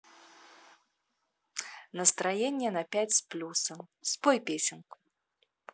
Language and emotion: Russian, positive